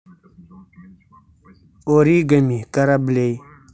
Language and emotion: Russian, neutral